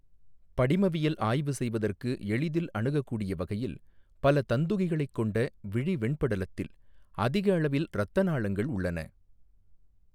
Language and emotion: Tamil, neutral